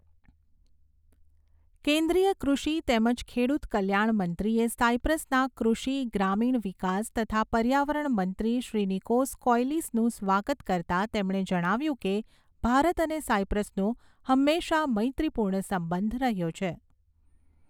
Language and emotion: Gujarati, neutral